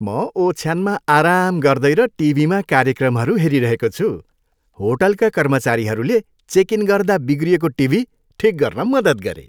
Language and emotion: Nepali, happy